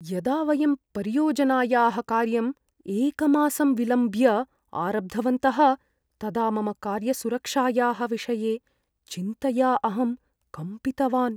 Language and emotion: Sanskrit, fearful